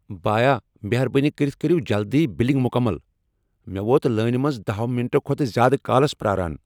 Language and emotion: Kashmiri, angry